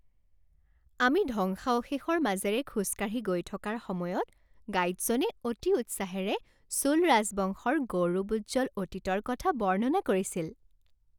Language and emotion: Assamese, happy